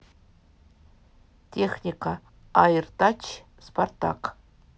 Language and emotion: Russian, neutral